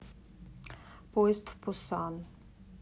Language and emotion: Russian, neutral